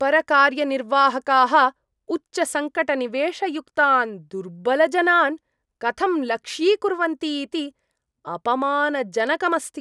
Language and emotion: Sanskrit, disgusted